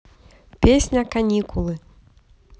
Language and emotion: Russian, positive